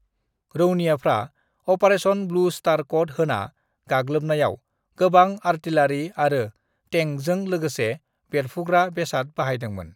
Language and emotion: Bodo, neutral